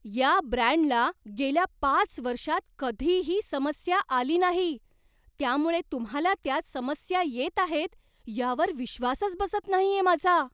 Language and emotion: Marathi, surprised